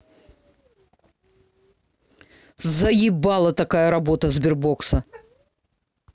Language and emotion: Russian, angry